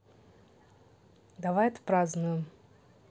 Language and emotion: Russian, neutral